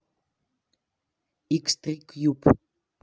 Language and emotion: Russian, neutral